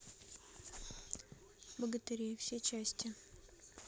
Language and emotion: Russian, neutral